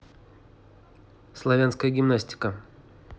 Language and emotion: Russian, neutral